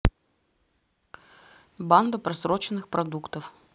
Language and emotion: Russian, neutral